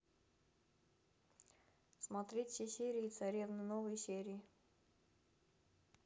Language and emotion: Russian, neutral